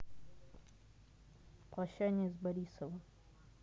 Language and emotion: Russian, neutral